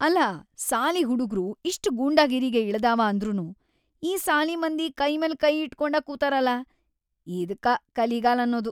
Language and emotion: Kannada, disgusted